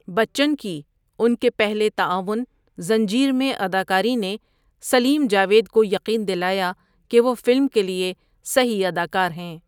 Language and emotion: Urdu, neutral